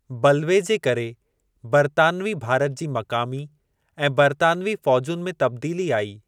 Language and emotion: Sindhi, neutral